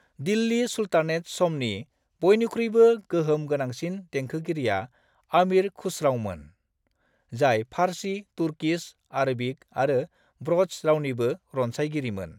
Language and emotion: Bodo, neutral